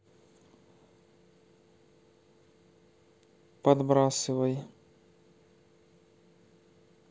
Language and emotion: Russian, neutral